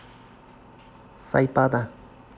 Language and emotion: Russian, neutral